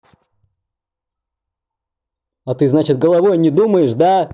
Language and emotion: Russian, angry